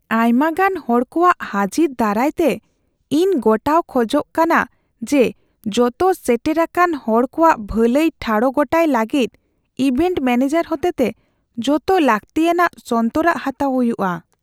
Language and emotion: Santali, fearful